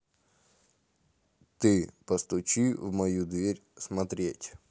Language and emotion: Russian, neutral